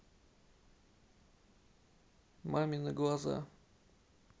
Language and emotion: Russian, neutral